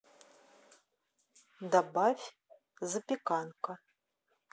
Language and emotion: Russian, neutral